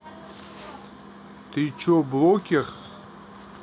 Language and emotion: Russian, neutral